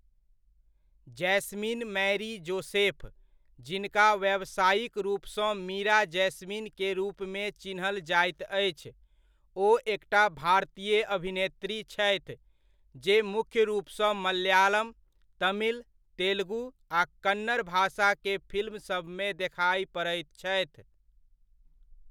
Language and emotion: Maithili, neutral